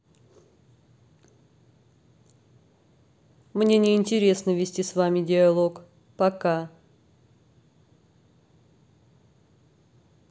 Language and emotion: Russian, neutral